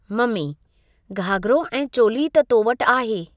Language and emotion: Sindhi, neutral